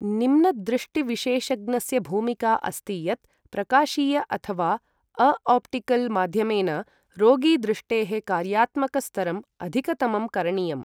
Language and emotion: Sanskrit, neutral